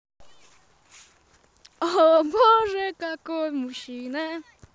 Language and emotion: Russian, positive